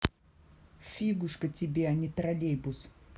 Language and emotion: Russian, angry